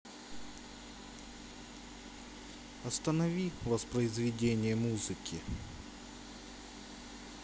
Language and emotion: Russian, sad